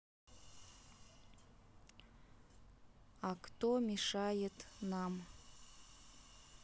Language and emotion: Russian, neutral